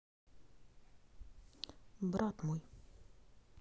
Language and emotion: Russian, neutral